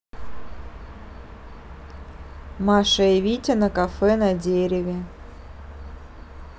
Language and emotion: Russian, neutral